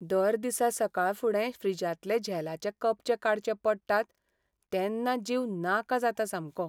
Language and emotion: Goan Konkani, sad